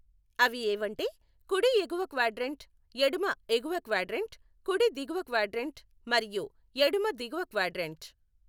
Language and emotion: Telugu, neutral